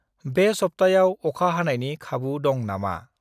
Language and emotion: Bodo, neutral